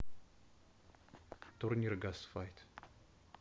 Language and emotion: Russian, neutral